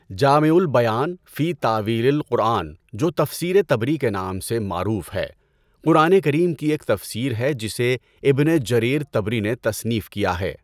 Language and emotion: Urdu, neutral